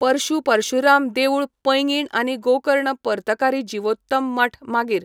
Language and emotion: Goan Konkani, neutral